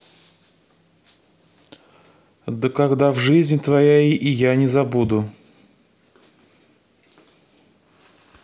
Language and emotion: Russian, neutral